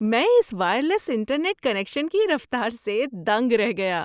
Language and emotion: Urdu, surprised